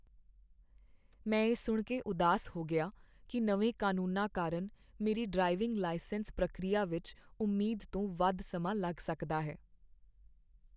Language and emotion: Punjabi, sad